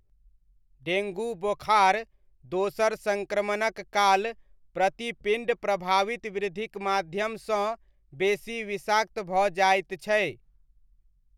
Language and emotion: Maithili, neutral